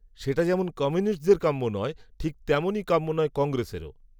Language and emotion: Bengali, neutral